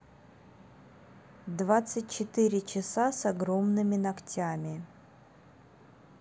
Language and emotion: Russian, neutral